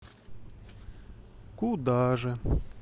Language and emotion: Russian, neutral